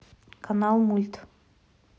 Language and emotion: Russian, neutral